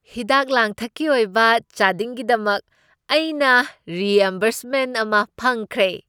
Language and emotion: Manipuri, happy